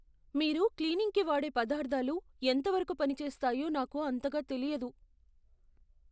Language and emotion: Telugu, fearful